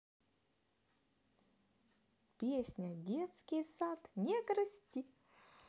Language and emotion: Russian, positive